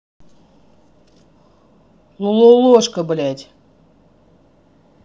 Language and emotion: Russian, angry